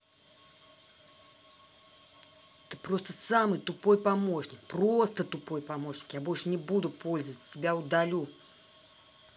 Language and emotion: Russian, angry